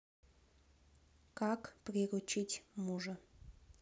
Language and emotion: Russian, neutral